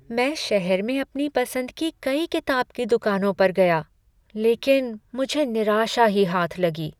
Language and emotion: Hindi, sad